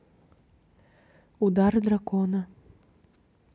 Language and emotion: Russian, neutral